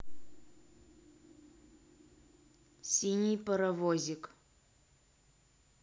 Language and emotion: Russian, neutral